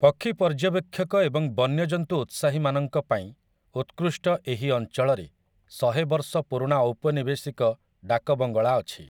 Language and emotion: Odia, neutral